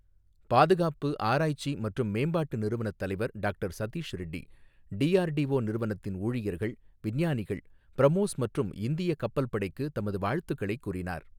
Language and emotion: Tamil, neutral